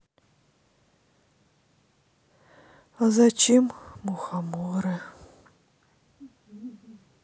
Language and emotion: Russian, sad